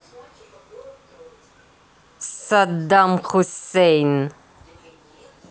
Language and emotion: Russian, angry